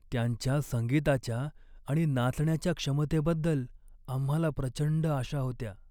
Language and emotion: Marathi, sad